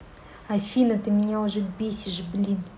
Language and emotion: Russian, angry